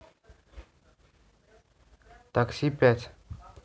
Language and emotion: Russian, neutral